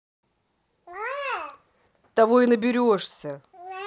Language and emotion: Russian, angry